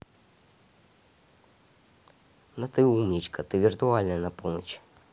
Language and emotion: Russian, positive